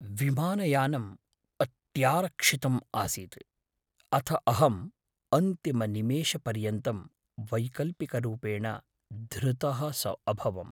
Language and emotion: Sanskrit, fearful